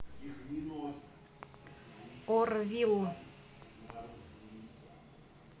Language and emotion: Russian, neutral